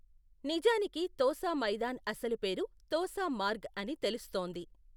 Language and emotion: Telugu, neutral